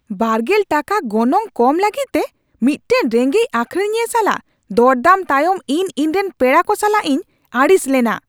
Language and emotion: Santali, angry